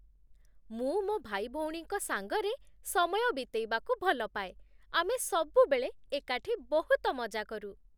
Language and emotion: Odia, happy